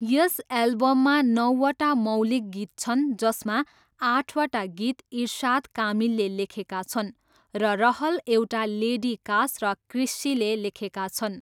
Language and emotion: Nepali, neutral